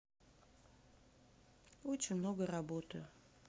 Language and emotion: Russian, sad